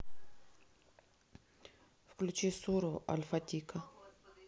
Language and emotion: Russian, neutral